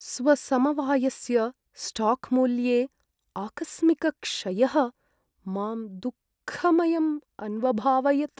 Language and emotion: Sanskrit, sad